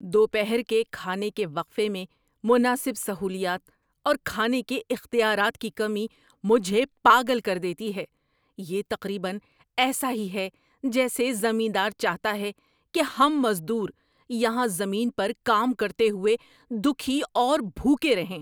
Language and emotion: Urdu, angry